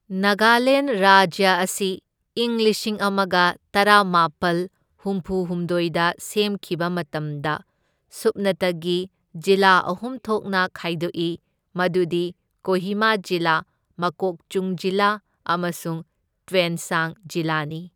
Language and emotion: Manipuri, neutral